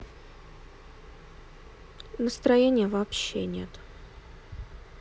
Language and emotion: Russian, sad